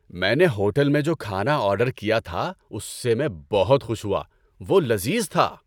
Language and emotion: Urdu, happy